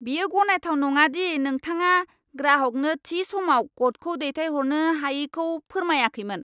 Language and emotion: Bodo, angry